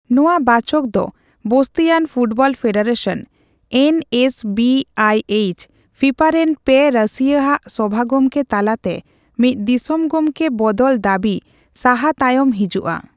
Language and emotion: Santali, neutral